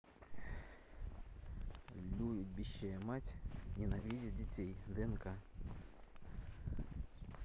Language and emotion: Russian, neutral